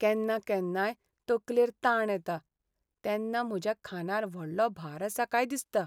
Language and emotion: Goan Konkani, sad